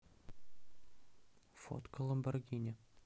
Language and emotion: Russian, neutral